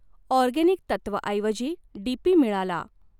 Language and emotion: Marathi, neutral